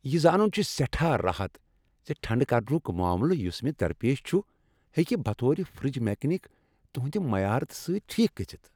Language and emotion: Kashmiri, happy